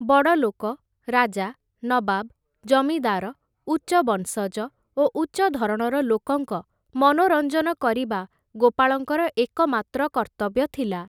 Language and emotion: Odia, neutral